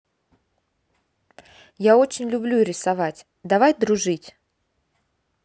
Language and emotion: Russian, neutral